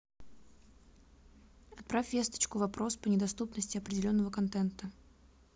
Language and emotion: Russian, neutral